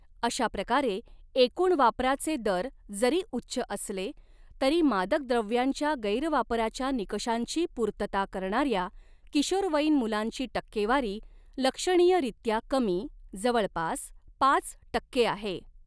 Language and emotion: Marathi, neutral